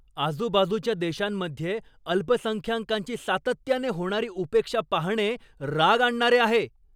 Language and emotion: Marathi, angry